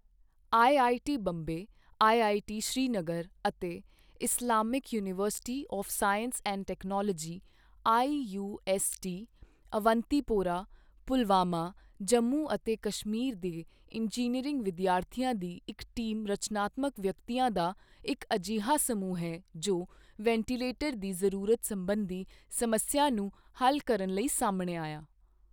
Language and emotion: Punjabi, neutral